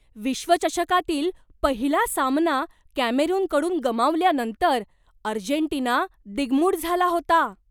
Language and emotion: Marathi, surprised